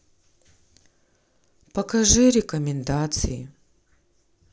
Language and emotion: Russian, sad